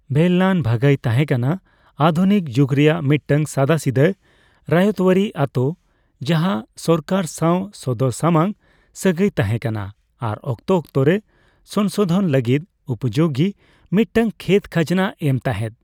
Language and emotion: Santali, neutral